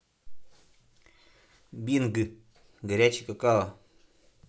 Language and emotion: Russian, neutral